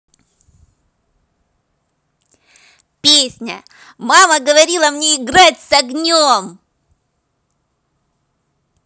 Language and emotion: Russian, positive